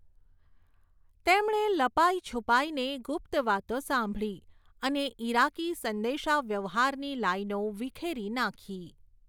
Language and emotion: Gujarati, neutral